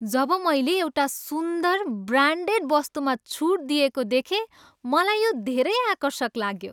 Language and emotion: Nepali, happy